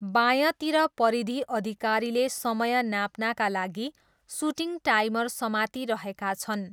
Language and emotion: Nepali, neutral